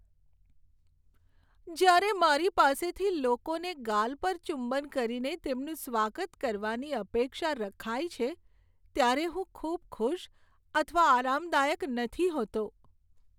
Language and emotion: Gujarati, sad